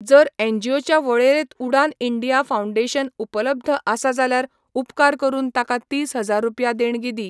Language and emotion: Goan Konkani, neutral